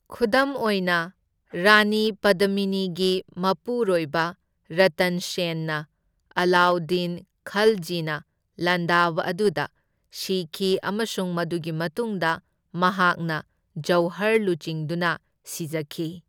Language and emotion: Manipuri, neutral